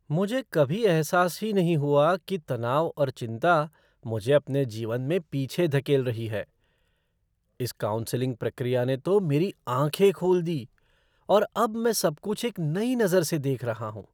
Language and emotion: Hindi, surprised